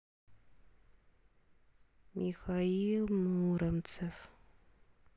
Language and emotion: Russian, sad